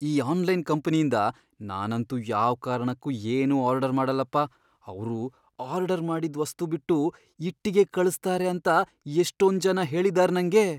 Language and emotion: Kannada, fearful